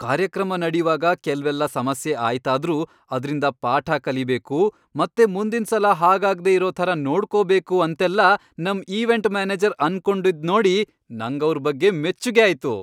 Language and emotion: Kannada, happy